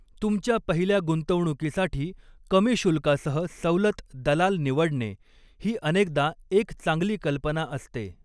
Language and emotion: Marathi, neutral